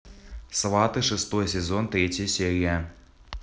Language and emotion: Russian, neutral